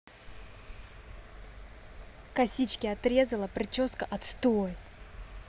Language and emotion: Russian, angry